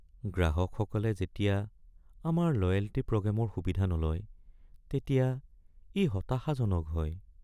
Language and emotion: Assamese, sad